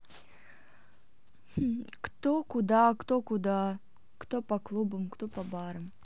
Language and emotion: Russian, neutral